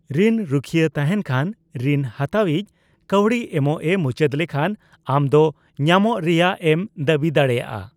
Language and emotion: Santali, neutral